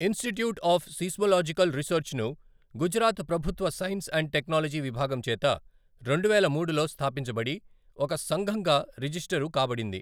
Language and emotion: Telugu, neutral